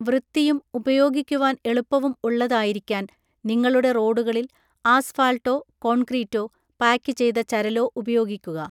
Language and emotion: Malayalam, neutral